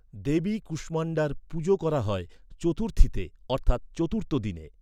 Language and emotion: Bengali, neutral